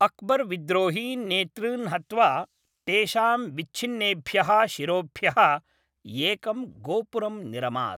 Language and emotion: Sanskrit, neutral